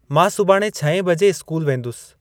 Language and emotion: Sindhi, neutral